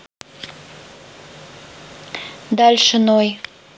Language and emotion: Russian, neutral